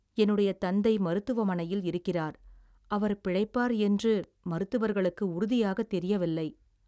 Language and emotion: Tamil, sad